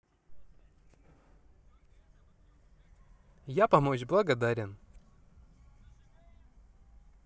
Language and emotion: Russian, positive